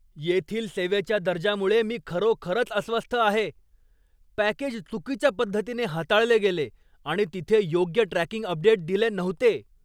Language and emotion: Marathi, angry